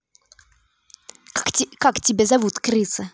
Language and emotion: Russian, angry